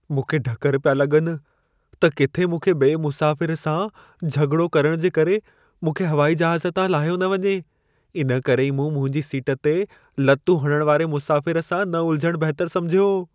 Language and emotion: Sindhi, fearful